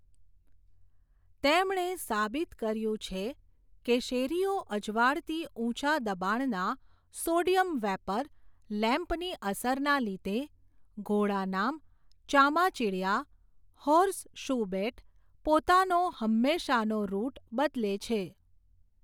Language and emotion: Gujarati, neutral